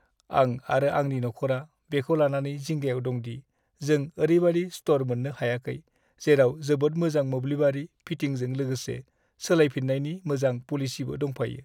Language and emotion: Bodo, sad